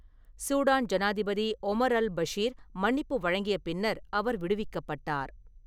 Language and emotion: Tamil, neutral